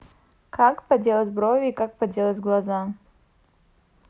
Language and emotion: Russian, neutral